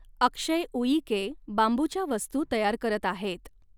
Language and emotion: Marathi, neutral